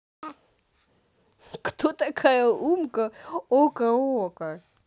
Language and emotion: Russian, positive